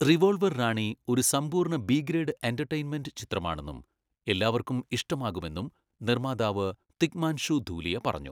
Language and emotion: Malayalam, neutral